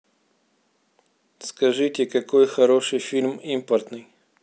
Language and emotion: Russian, neutral